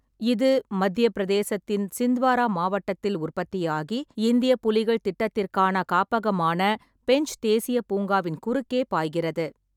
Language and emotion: Tamil, neutral